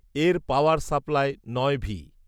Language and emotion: Bengali, neutral